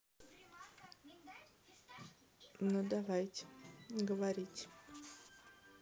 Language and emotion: Russian, neutral